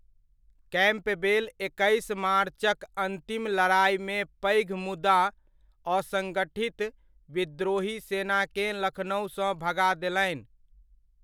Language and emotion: Maithili, neutral